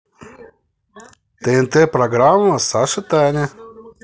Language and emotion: Russian, positive